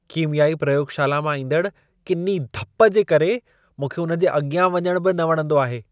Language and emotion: Sindhi, disgusted